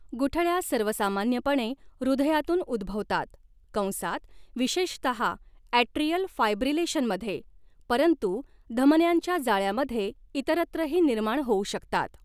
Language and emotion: Marathi, neutral